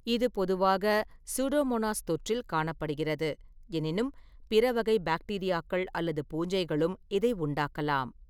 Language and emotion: Tamil, neutral